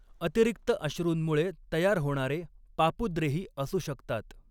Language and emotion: Marathi, neutral